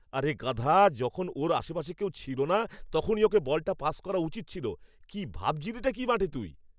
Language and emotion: Bengali, angry